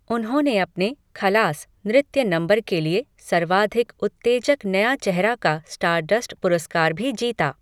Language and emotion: Hindi, neutral